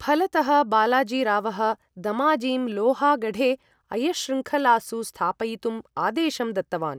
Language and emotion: Sanskrit, neutral